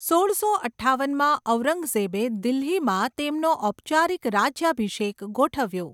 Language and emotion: Gujarati, neutral